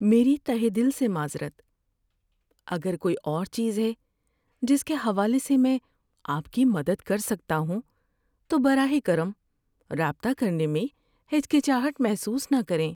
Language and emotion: Urdu, sad